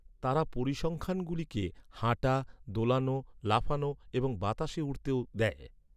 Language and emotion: Bengali, neutral